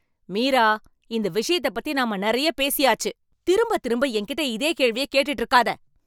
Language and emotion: Tamil, angry